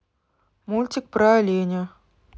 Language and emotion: Russian, neutral